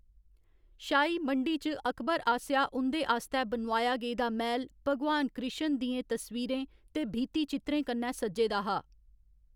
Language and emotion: Dogri, neutral